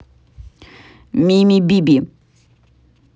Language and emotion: Russian, neutral